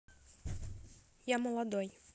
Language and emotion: Russian, neutral